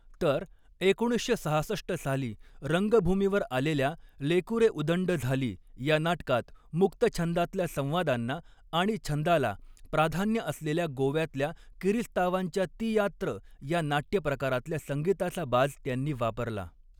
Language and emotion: Marathi, neutral